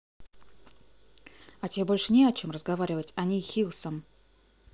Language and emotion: Russian, angry